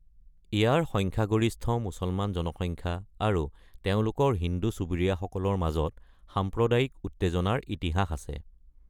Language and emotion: Assamese, neutral